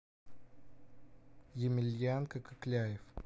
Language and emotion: Russian, neutral